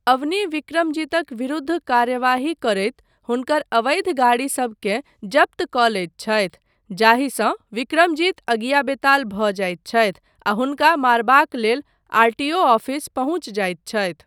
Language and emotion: Maithili, neutral